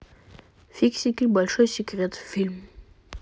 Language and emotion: Russian, neutral